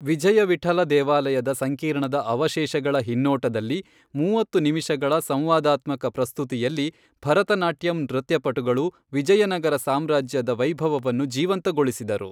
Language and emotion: Kannada, neutral